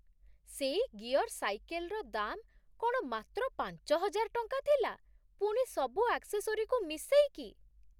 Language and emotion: Odia, surprised